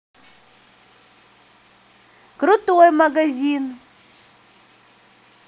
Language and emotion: Russian, positive